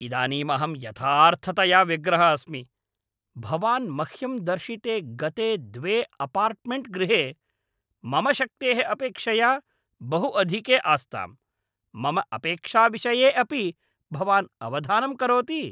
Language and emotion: Sanskrit, angry